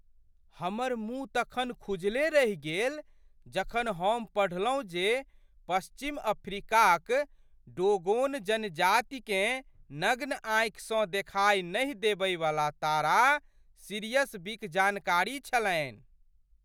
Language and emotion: Maithili, surprised